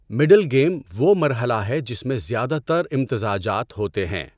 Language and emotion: Urdu, neutral